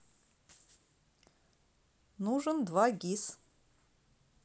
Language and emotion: Russian, neutral